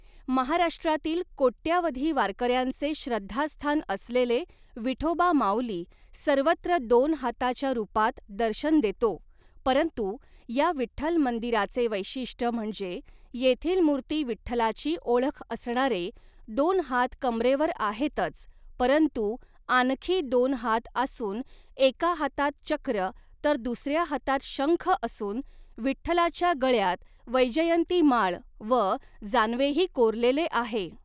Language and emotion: Marathi, neutral